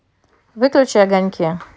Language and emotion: Russian, neutral